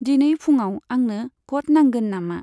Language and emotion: Bodo, neutral